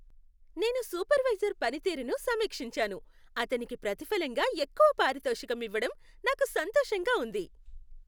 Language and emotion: Telugu, happy